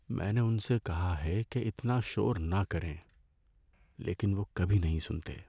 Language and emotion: Urdu, sad